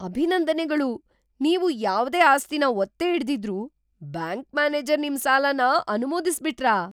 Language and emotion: Kannada, surprised